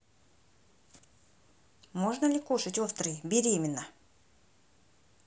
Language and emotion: Russian, neutral